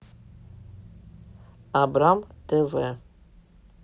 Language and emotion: Russian, neutral